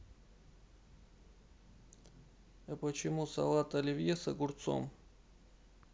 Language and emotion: Russian, sad